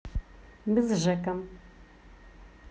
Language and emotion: Russian, positive